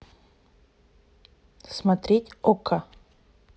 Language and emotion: Russian, neutral